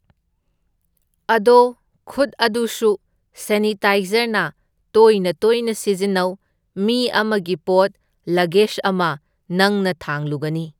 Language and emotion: Manipuri, neutral